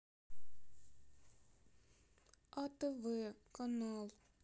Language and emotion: Russian, sad